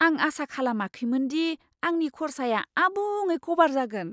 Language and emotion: Bodo, surprised